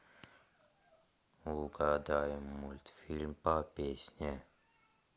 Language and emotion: Russian, neutral